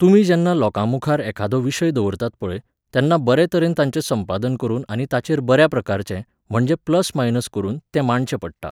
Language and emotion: Goan Konkani, neutral